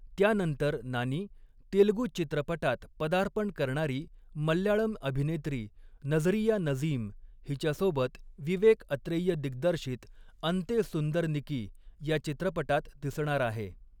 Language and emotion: Marathi, neutral